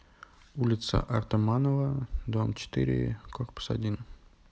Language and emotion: Russian, neutral